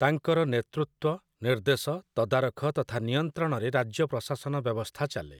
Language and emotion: Odia, neutral